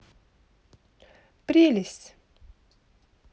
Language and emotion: Russian, positive